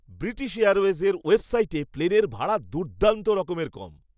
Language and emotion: Bengali, happy